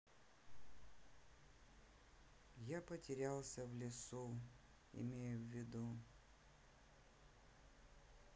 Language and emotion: Russian, sad